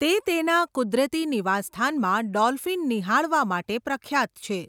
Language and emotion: Gujarati, neutral